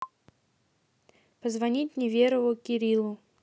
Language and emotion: Russian, neutral